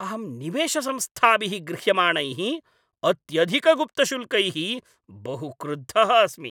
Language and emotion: Sanskrit, angry